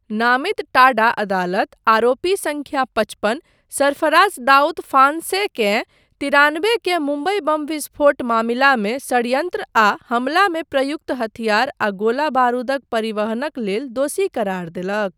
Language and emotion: Maithili, neutral